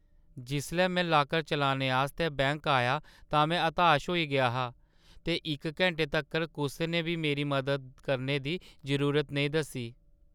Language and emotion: Dogri, sad